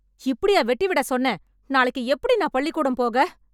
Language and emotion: Tamil, angry